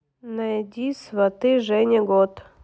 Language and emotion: Russian, neutral